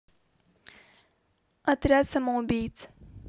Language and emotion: Russian, neutral